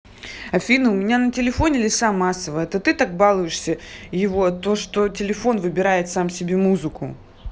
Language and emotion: Russian, angry